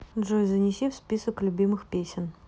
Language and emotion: Russian, neutral